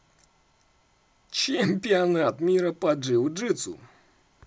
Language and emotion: Russian, positive